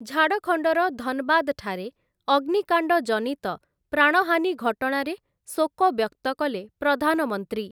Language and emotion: Odia, neutral